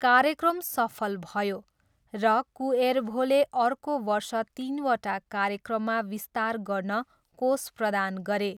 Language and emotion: Nepali, neutral